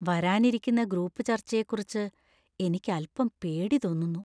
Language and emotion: Malayalam, fearful